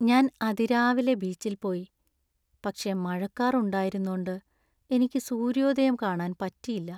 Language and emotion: Malayalam, sad